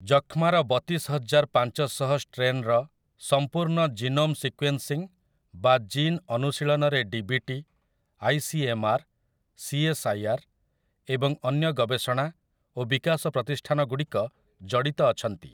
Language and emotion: Odia, neutral